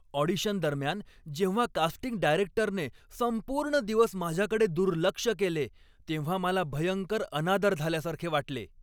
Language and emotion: Marathi, angry